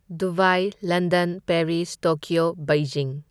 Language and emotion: Manipuri, neutral